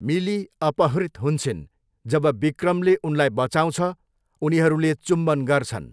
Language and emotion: Nepali, neutral